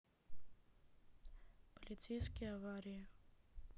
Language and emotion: Russian, neutral